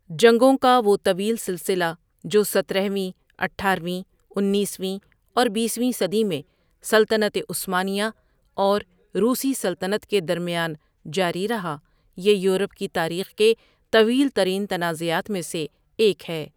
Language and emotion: Urdu, neutral